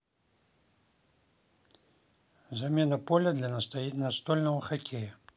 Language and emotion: Russian, neutral